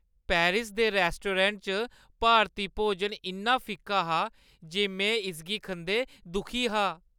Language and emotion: Dogri, sad